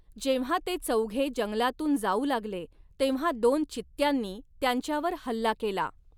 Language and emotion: Marathi, neutral